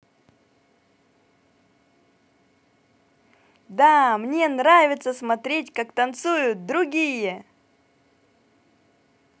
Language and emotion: Russian, positive